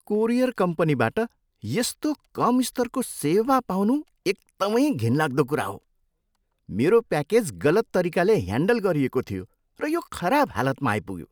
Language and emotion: Nepali, disgusted